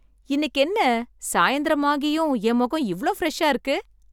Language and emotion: Tamil, surprised